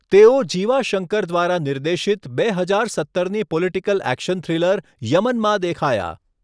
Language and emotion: Gujarati, neutral